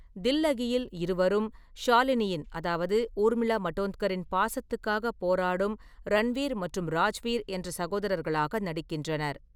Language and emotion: Tamil, neutral